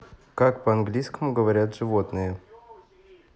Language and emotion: Russian, neutral